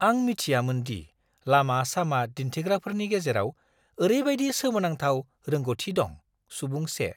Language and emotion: Bodo, surprised